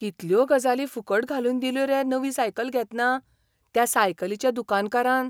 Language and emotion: Goan Konkani, surprised